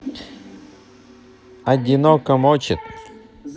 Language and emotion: Russian, neutral